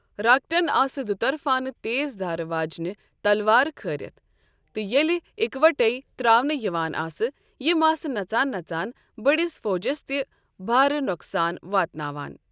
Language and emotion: Kashmiri, neutral